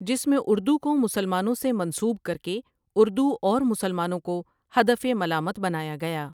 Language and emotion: Urdu, neutral